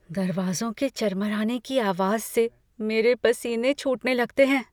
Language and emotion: Hindi, fearful